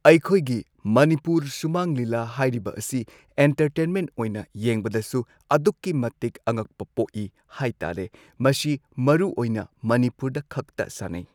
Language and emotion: Manipuri, neutral